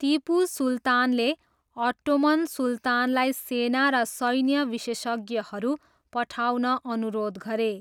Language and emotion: Nepali, neutral